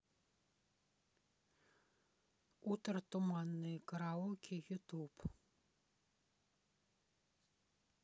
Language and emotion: Russian, neutral